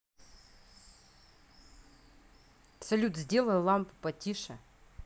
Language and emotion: Russian, angry